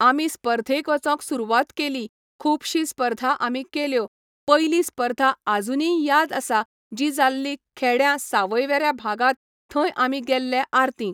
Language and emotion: Goan Konkani, neutral